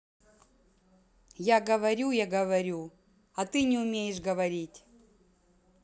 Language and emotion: Russian, angry